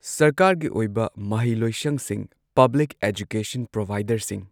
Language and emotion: Manipuri, neutral